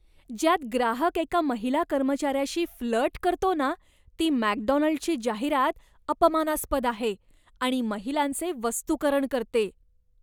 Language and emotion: Marathi, disgusted